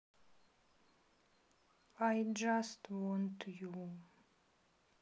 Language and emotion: Russian, sad